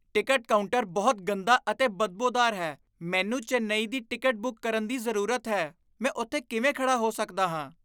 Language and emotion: Punjabi, disgusted